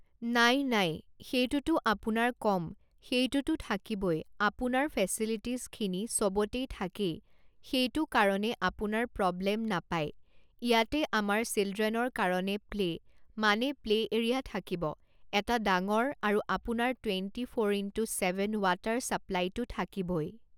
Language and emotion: Assamese, neutral